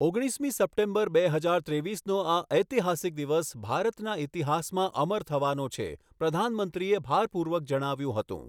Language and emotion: Gujarati, neutral